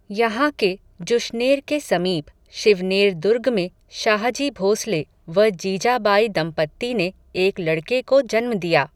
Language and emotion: Hindi, neutral